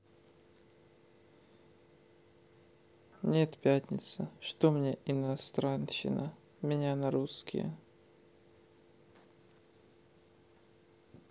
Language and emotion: Russian, neutral